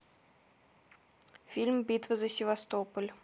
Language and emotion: Russian, neutral